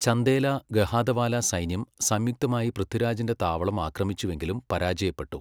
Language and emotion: Malayalam, neutral